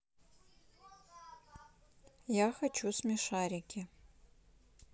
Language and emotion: Russian, neutral